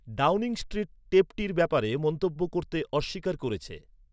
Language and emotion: Bengali, neutral